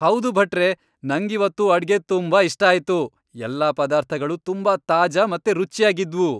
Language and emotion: Kannada, happy